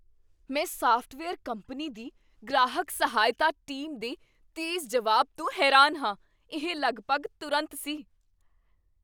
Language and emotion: Punjabi, surprised